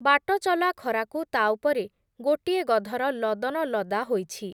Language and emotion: Odia, neutral